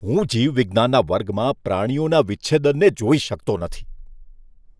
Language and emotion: Gujarati, disgusted